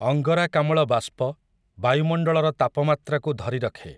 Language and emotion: Odia, neutral